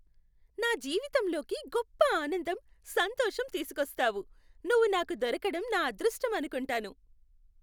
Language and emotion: Telugu, happy